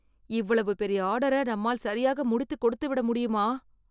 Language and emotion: Tamil, fearful